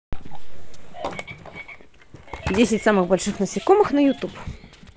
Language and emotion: Russian, positive